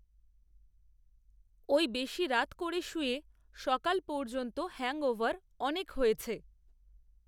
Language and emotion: Bengali, neutral